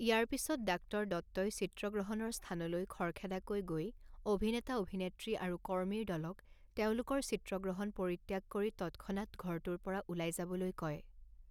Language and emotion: Assamese, neutral